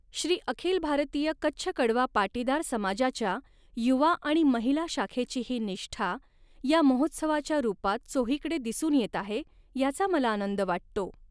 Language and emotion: Marathi, neutral